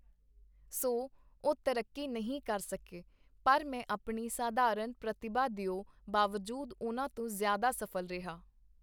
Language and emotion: Punjabi, neutral